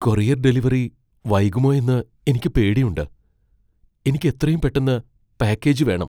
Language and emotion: Malayalam, fearful